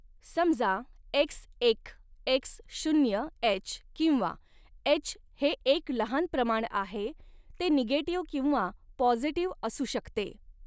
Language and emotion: Marathi, neutral